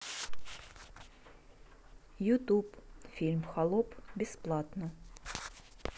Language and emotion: Russian, neutral